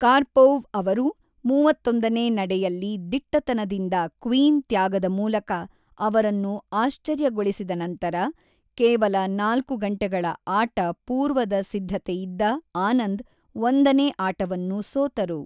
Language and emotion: Kannada, neutral